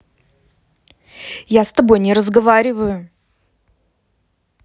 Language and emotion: Russian, angry